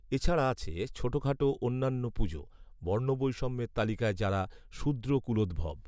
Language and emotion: Bengali, neutral